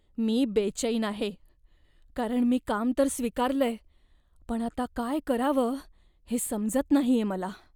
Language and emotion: Marathi, fearful